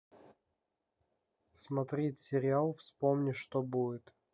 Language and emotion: Russian, neutral